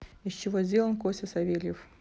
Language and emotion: Russian, neutral